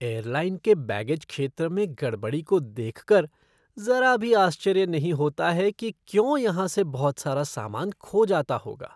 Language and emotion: Hindi, disgusted